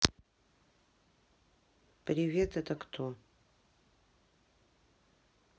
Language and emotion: Russian, neutral